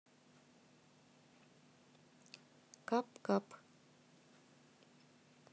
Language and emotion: Russian, neutral